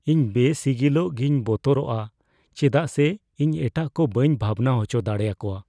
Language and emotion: Santali, fearful